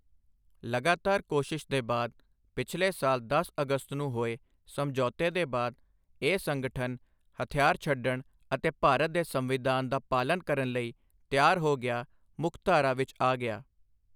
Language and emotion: Punjabi, neutral